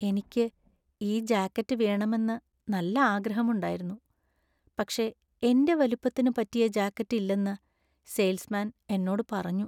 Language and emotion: Malayalam, sad